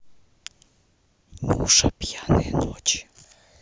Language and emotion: Russian, neutral